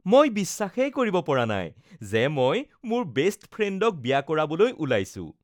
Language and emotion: Assamese, happy